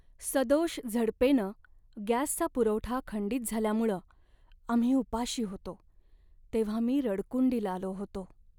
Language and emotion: Marathi, sad